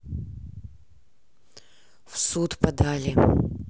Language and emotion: Russian, neutral